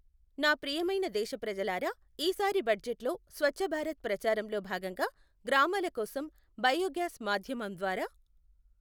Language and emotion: Telugu, neutral